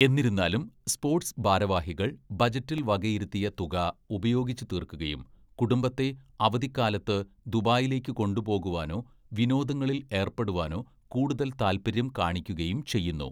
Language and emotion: Malayalam, neutral